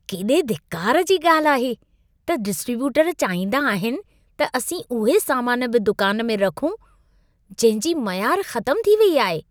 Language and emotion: Sindhi, disgusted